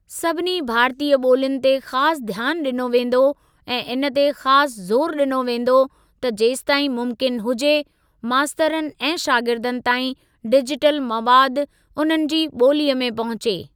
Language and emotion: Sindhi, neutral